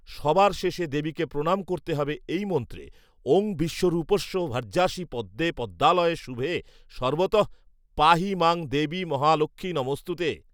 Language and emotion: Bengali, neutral